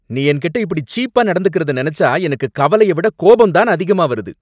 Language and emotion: Tamil, angry